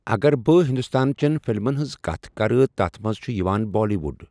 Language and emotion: Kashmiri, neutral